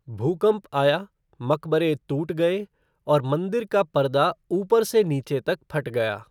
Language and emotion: Hindi, neutral